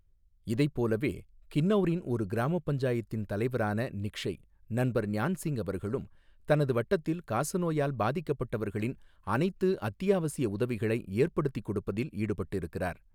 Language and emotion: Tamil, neutral